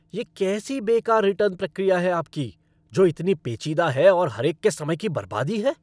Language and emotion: Hindi, angry